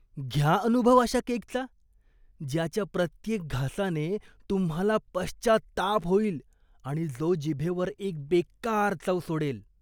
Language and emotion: Marathi, disgusted